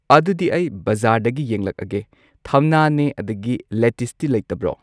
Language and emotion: Manipuri, neutral